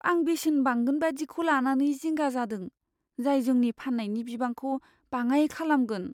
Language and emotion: Bodo, fearful